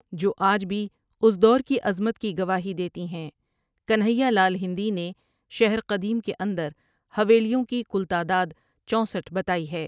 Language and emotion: Urdu, neutral